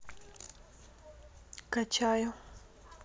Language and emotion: Russian, neutral